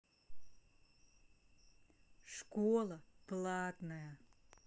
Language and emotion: Russian, neutral